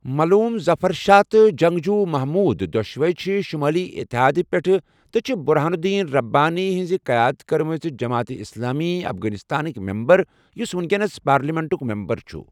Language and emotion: Kashmiri, neutral